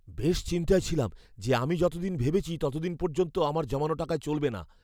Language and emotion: Bengali, fearful